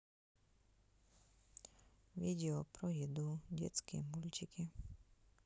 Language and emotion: Russian, sad